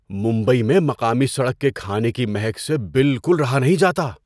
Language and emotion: Urdu, surprised